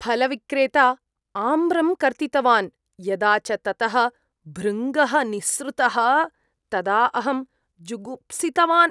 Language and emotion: Sanskrit, disgusted